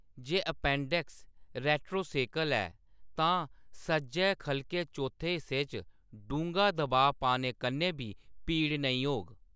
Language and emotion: Dogri, neutral